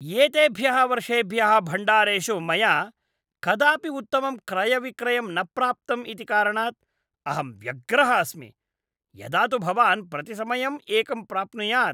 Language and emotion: Sanskrit, disgusted